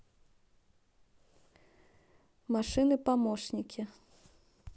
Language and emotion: Russian, neutral